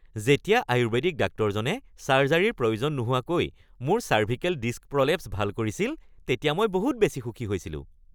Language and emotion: Assamese, happy